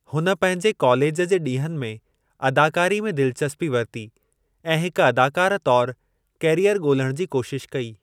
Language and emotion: Sindhi, neutral